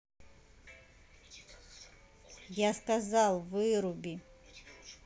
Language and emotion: Russian, angry